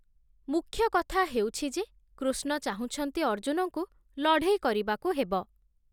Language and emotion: Odia, neutral